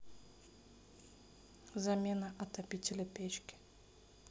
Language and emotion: Russian, neutral